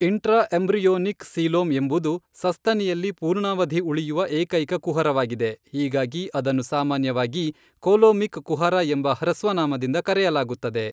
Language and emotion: Kannada, neutral